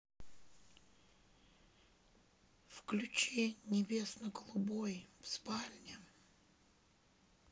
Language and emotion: Russian, neutral